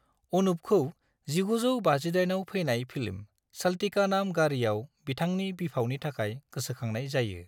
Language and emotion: Bodo, neutral